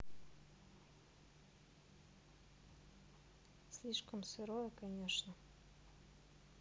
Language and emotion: Russian, neutral